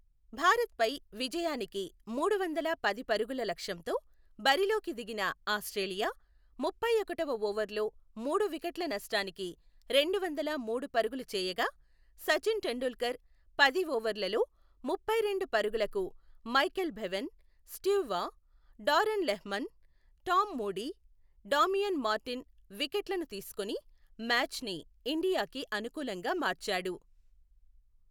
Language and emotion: Telugu, neutral